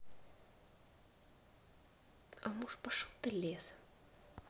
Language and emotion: Russian, neutral